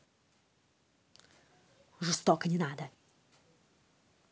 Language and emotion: Russian, angry